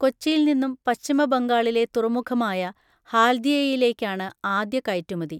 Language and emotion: Malayalam, neutral